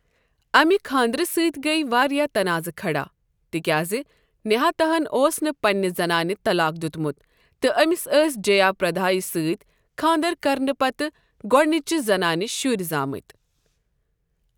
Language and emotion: Kashmiri, neutral